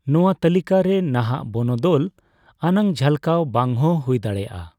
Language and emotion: Santali, neutral